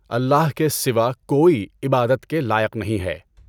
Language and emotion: Urdu, neutral